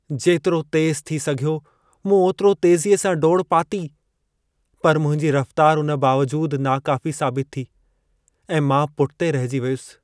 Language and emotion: Sindhi, sad